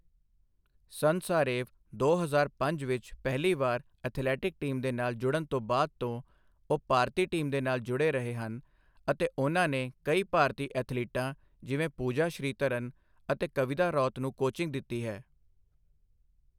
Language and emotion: Punjabi, neutral